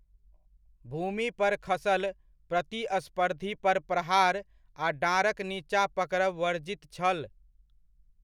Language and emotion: Maithili, neutral